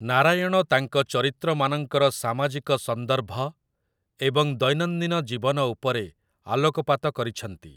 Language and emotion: Odia, neutral